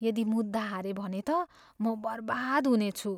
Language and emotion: Nepali, fearful